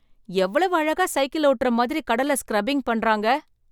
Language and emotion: Tamil, surprised